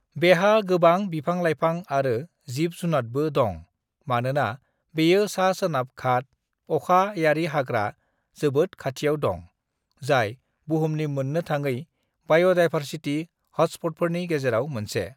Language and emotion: Bodo, neutral